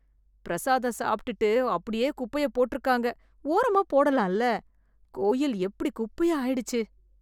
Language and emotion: Tamil, disgusted